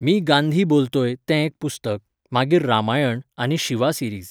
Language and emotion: Goan Konkani, neutral